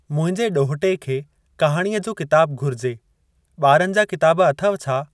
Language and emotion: Sindhi, neutral